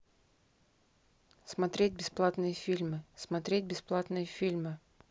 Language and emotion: Russian, neutral